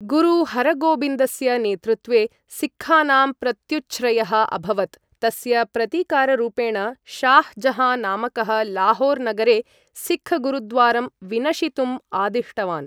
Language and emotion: Sanskrit, neutral